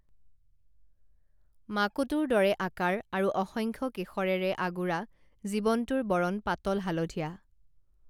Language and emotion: Assamese, neutral